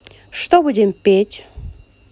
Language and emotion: Russian, positive